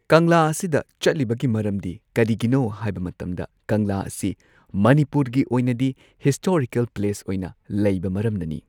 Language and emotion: Manipuri, neutral